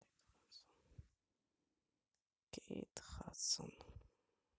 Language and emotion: Russian, sad